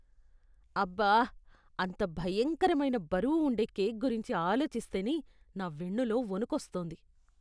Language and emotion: Telugu, disgusted